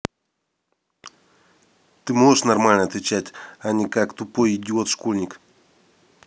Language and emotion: Russian, angry